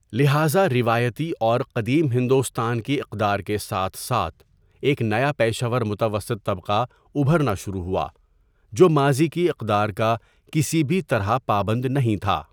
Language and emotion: Urdu, neutral